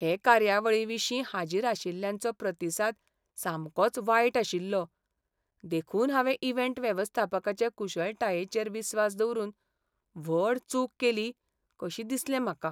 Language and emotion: Goan Konkani, sad